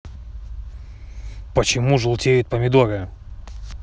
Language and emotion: Russian, angry